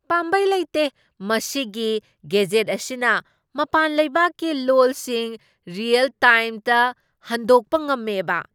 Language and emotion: Manipuri, surprised